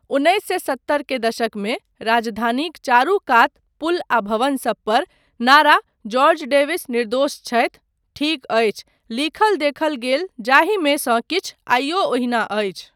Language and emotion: Maithili, neutral